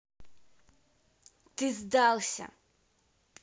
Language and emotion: Russian, angry